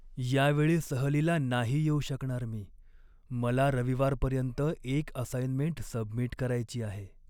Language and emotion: Marathi, sad